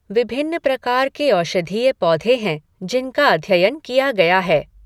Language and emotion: Hindi, neutral